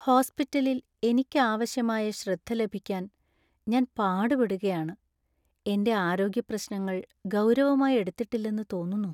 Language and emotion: Malayalam, sad